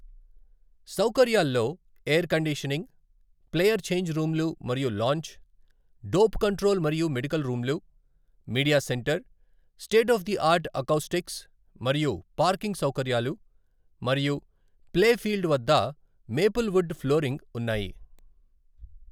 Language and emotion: Telugu, neutral